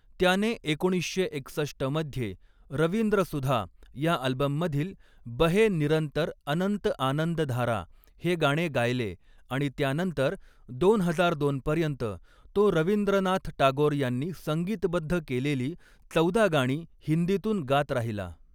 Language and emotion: Marathi, neutral